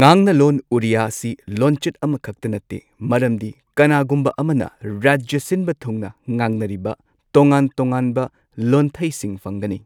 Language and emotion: Manipuri, neutral